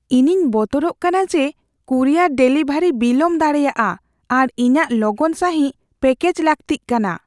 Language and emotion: Santali, fearful